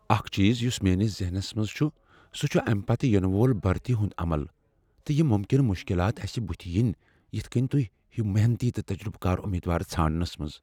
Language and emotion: Kashmiri, fearful